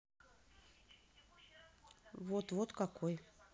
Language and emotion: Russian, neutral